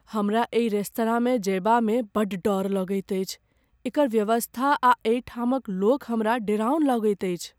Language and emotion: Maithili, fearful